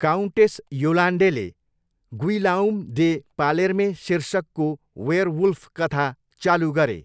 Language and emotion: Nepali, neutral